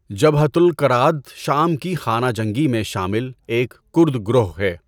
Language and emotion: Urdu, neutral